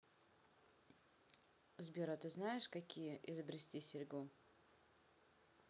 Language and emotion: Russian, neutral